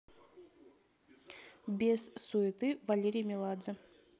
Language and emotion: Russian, neutral